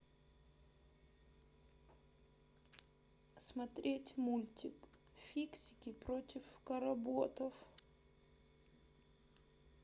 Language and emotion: Russian, sad